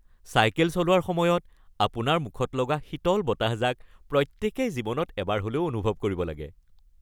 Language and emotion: Assamese, happy